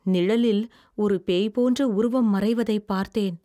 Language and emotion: Tamil, fearful